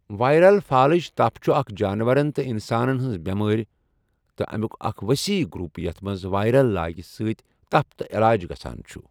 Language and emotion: Kashmiri, neutral